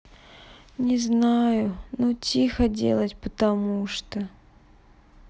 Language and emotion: Russian, sad